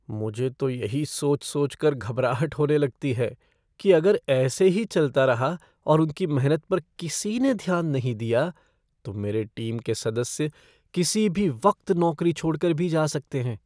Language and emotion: Hindi, fearful